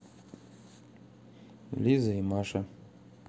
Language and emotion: Russian, neutral